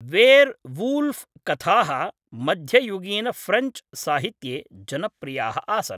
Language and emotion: Sanskrit, neutral